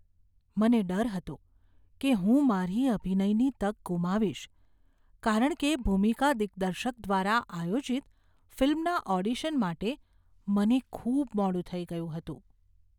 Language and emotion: Gujarati, fearful